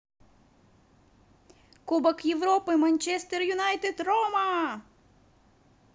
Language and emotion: Russian, positive